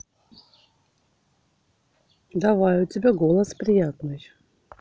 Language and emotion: Russian, neutral